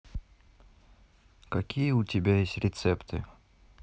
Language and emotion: Russian, neutral